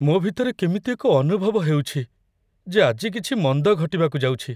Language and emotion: Odia, fearful